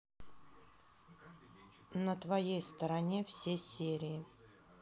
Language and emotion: Russian, neutral